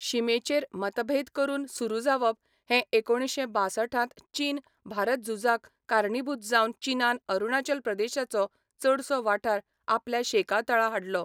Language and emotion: Goan Konkani, neutral